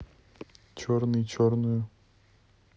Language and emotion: Russian, neutral